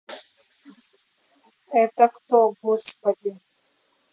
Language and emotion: Russian, neutral